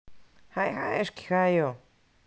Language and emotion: Russian, neutral